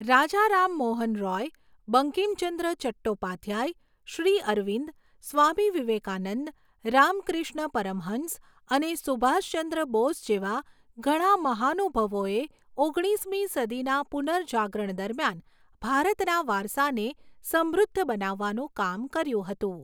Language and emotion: Gujarati, neutral